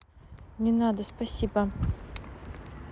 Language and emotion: Russian, neutral